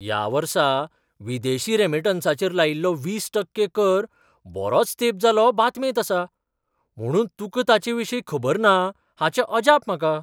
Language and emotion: Goan Konkani, surprised